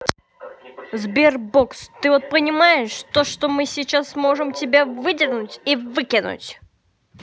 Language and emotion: Russian, angry